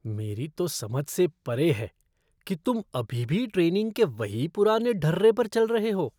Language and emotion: Hindi, disgusted